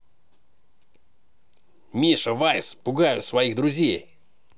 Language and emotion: Russian, positive